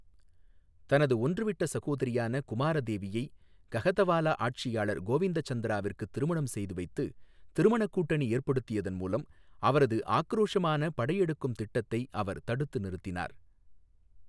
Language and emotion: Tamil, neutral